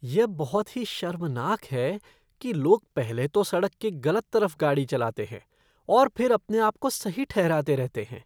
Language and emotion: Hindi, disgusted